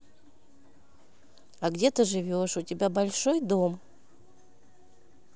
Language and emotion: Russian, neutral